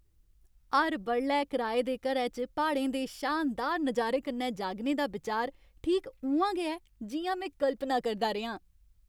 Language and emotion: Dogri, happy